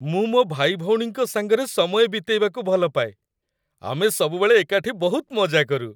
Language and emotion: Odia, happy